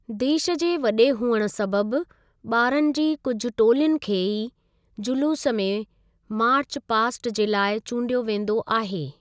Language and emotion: Sindhi, neutral